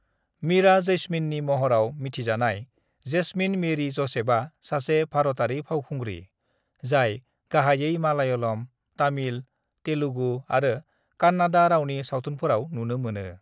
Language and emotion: Bodo, neutral